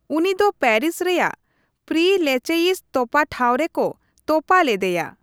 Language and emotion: Santali, neutral